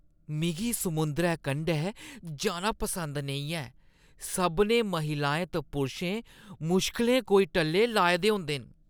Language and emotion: Dogri, disgusted